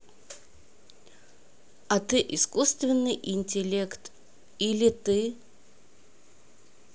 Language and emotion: Russian, neutral